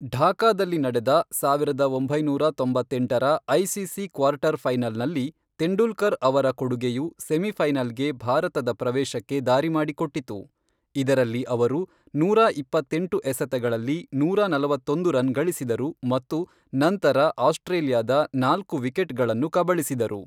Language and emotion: Kannada, neutral